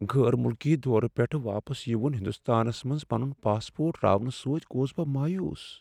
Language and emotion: Kashmiri, sad